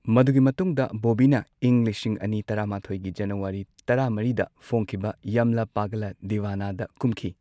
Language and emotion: Manipuri, neutral